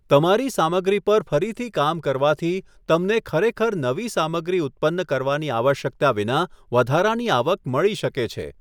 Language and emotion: Gujarati, neutral